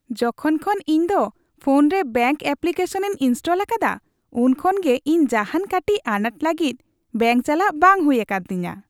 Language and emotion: Santali, happy